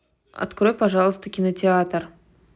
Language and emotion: Russian, neutral